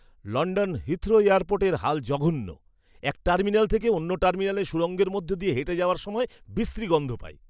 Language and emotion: Bengali, disgusted